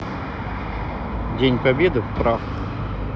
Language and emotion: Russian, neutral